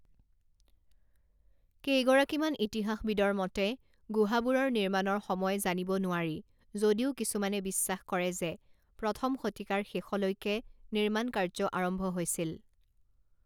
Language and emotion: Assamese, neutral